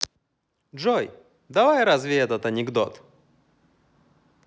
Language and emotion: Russian, positive